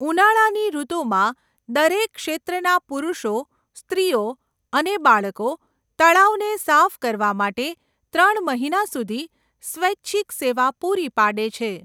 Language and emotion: Gujarati, neutral